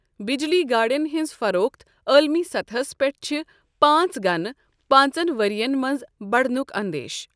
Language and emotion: Kashmiri, neutral